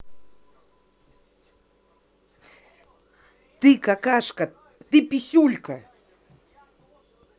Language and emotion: Russian, angry